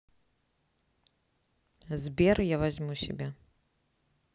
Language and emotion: Russian, neutral